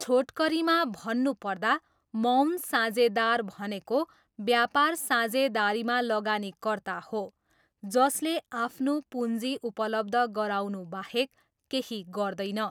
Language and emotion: Nepali, neutral